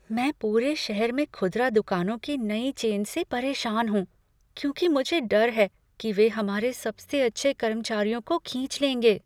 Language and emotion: Hindi, fearful